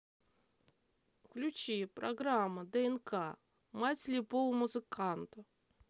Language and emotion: Russian, neutral